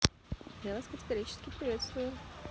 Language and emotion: Russian, neutral